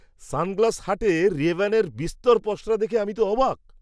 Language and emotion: Bengali, surprised